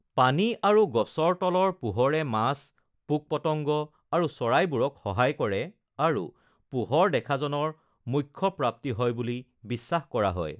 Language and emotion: Assamese, neutral